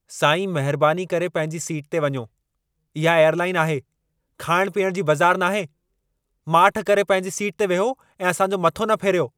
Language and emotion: Sindhi, angry